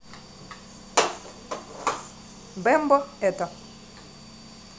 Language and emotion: Russian, neutral